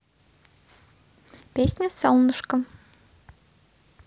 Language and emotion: Russian, positive